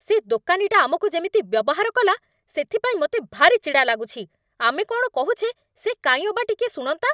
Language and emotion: Odia, angry